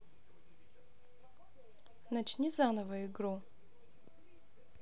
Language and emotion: Russian, neutral